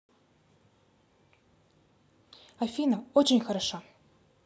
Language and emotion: Russian, positive